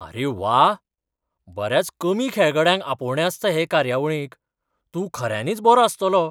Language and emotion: Goan Konkani, surprised